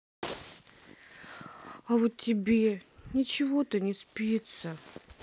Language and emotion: Russian, sad